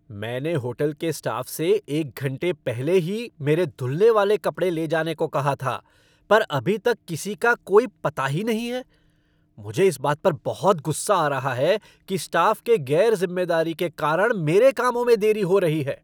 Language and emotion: Hindi, angry